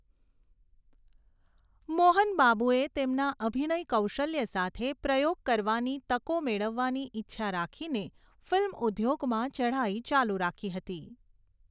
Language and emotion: Gujarati, neutral